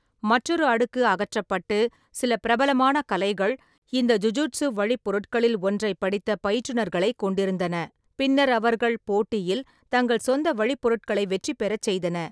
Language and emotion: Tamil, neutral